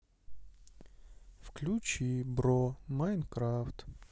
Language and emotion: Russian, sad